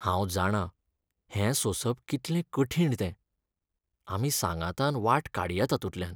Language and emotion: Goan Konkani, sad